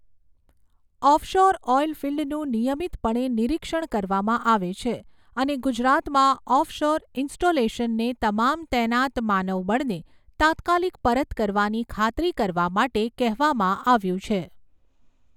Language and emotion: Gujarati, neutral